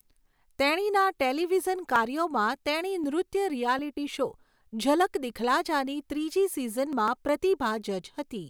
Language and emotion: Gujarati, neutral